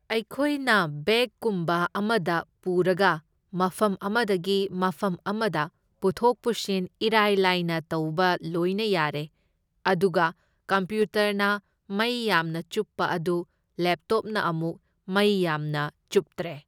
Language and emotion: Manipuri, neutral